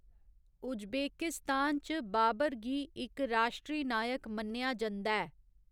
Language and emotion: Dogri, neutral